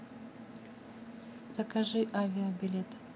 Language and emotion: Russian, neutral